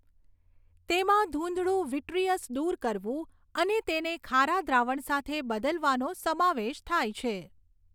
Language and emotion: Gujarati, neutral